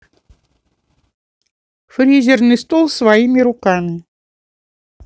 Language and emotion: Russian, neutral